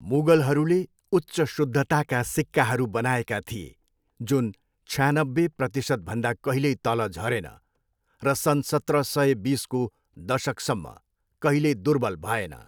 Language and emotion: Nepali, neutral